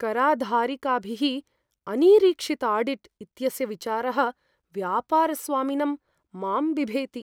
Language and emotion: Sanskrit, fearful